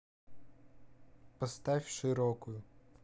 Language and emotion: Russian, neutral